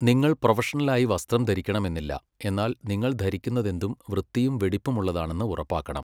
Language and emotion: Malayalam, neutral